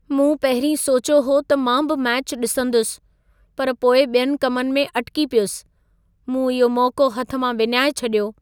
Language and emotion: Sindhi, sad